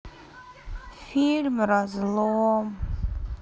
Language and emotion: Russian, sad